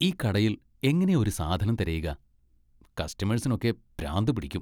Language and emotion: Malayalam, disgusted